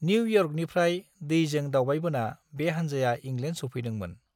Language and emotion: Bodo, neutral